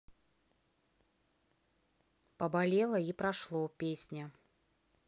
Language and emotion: Russian, neutral